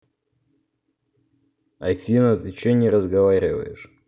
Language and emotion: Russian, neutral